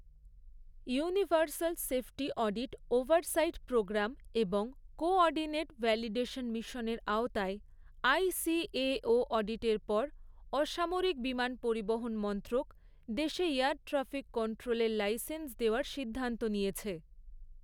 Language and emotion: Bengali, neutral